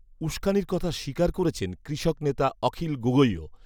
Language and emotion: Bengali, neutral